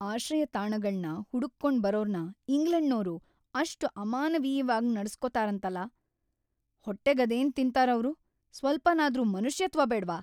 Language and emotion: Kannada, angry